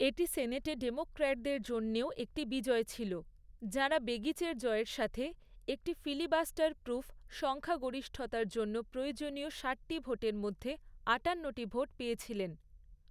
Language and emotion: Bengali, neutral